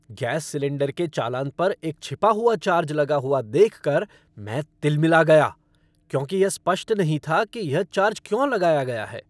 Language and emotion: Hindi, angry